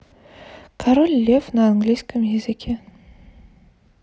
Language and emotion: Russian, neutral